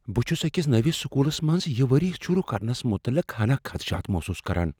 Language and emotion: Kashmiri, fearful